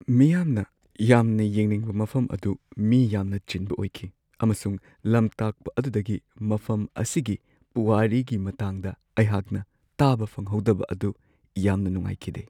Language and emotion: Manipuri, sad